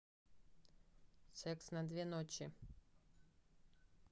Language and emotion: Russian, neutral